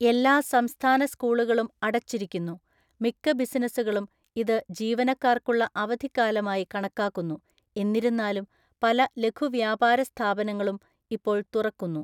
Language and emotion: Malayalam, neutral